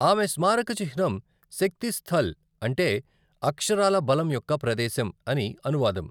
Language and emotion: Telugu, neutral